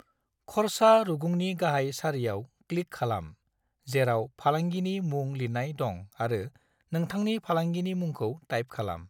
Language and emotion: Bodo, neutral